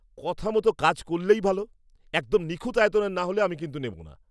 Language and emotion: Bengali, angry